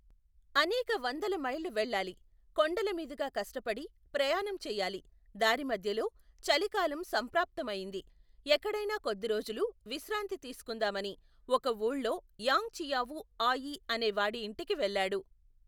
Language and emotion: Telugu, neutral